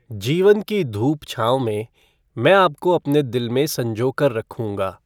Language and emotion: Hindi, neutral